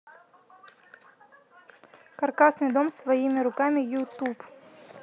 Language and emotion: Russian, neutral